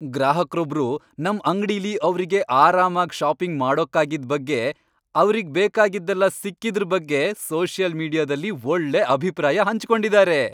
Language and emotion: Kannada, happy